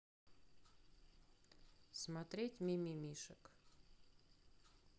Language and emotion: Russian, neutral